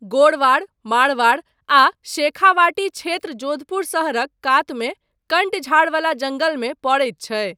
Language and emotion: Maithili, neutral